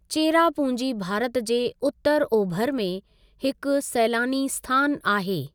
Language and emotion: Sindhi, neutral